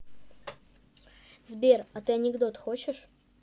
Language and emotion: Russian, neutral